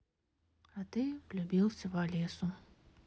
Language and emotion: Russian, sad